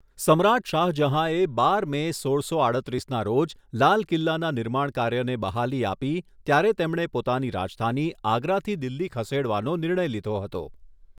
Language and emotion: Gujarati, neutral